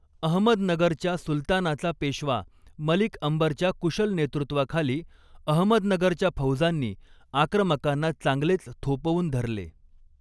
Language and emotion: Marathi, neutral